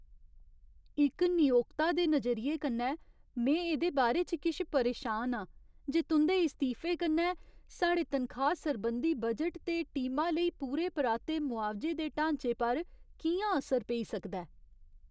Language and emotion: Dogri, fearful